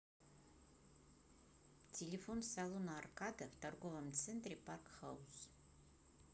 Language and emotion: Russian, neutral